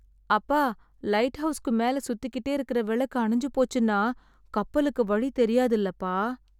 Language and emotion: Tamil, sad